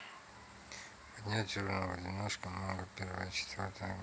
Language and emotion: Russian, neutral